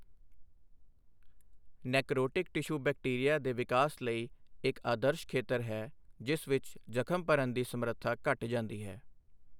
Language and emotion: Punjabi, neutral